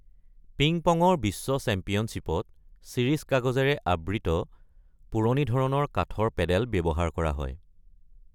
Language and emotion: Assamese, neutral